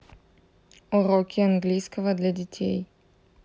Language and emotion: Russian, neutral